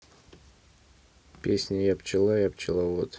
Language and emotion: Russian, neutral